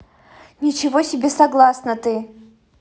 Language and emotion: Russian, angry